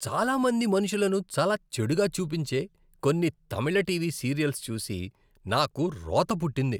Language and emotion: Telugu, disgusted